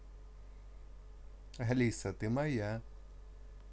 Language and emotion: Russian, positive